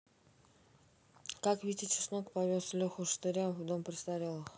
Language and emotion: Russian, neutral